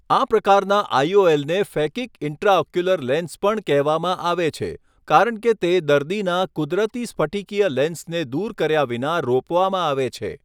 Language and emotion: Gujarati, neutral